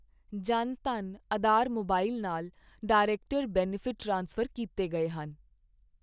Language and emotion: Punjabi, neutral